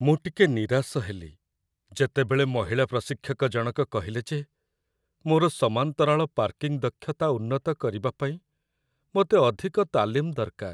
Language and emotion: Odia, sad